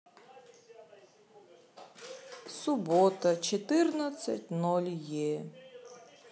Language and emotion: Russian, sad